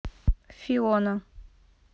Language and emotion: Russian, neutral